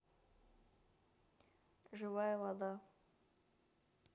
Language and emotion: Russian, neutral